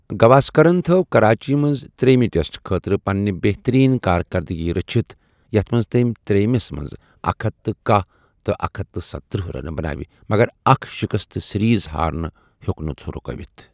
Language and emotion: Kashmiri, neutral